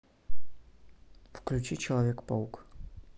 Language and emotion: Russian, neutral